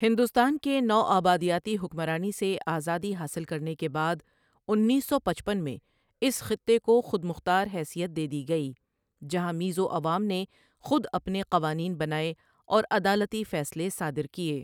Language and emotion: Urdu, neutral